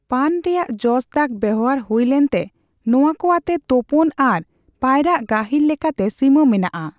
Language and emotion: Santali, neutral